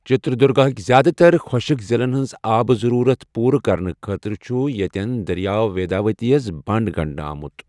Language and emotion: Kashmiri, neutral